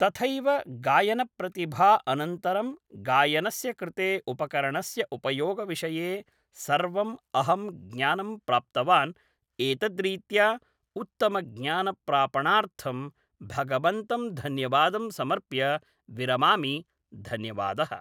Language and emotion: Sanskrit, neutral